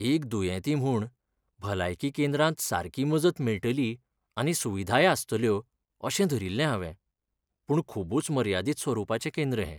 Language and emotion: Goan Konkani, sad